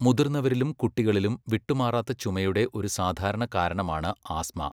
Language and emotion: Malayalam, neutral